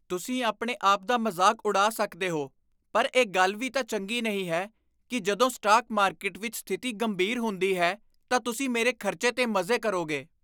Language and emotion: Punjabi, disgusted